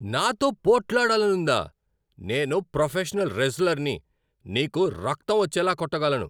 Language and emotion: Telugu, angry